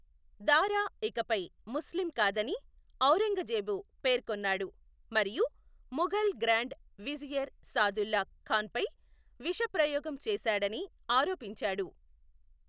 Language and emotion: Telugu, neutral